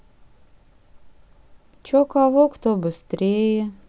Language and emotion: Russian, neutral